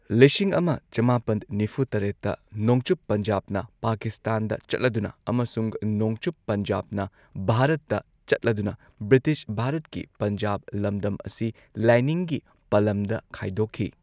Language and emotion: Manipuri, neutral